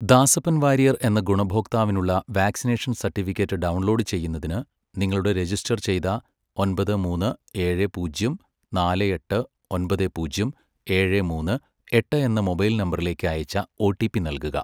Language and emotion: Malayalam, neutral